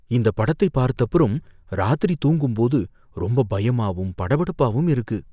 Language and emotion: Tamil, fearful